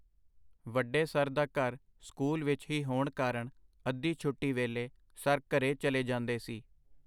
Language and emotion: Punjabi, neutral